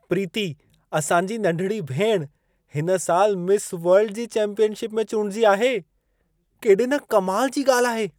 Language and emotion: Sindhi, surprised